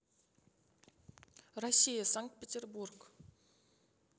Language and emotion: Russian, neutral